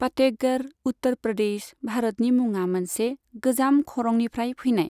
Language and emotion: Bodo, neutral